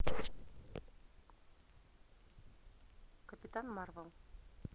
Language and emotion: Russian, neutral